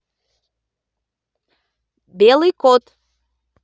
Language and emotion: Russian, positive